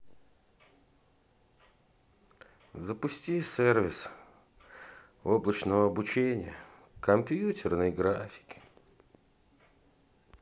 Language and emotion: Russian, sad